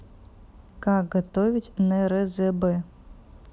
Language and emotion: Russian, neutral